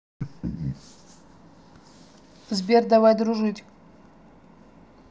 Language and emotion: Russian, neutral